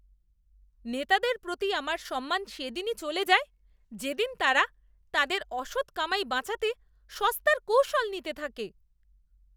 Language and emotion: Bengali, disgusted